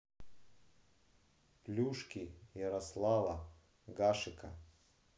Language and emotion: Russian, neutral